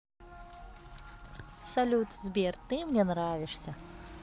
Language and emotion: Russian, positive